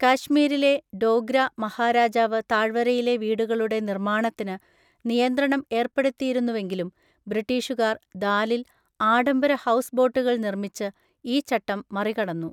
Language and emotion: Malayalam, neutral